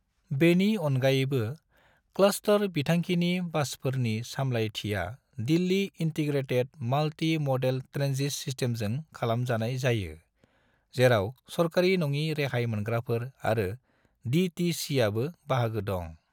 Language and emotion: Bodo, neutral